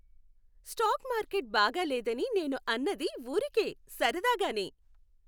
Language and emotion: Telugu, happy